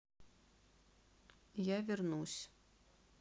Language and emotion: Russian, sad